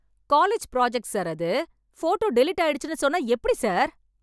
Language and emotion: Tamil, angry